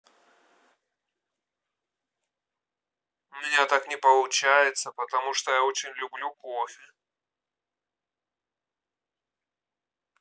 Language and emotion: Russian, neutral